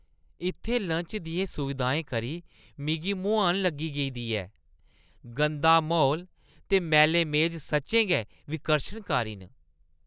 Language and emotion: Dogri, disgusted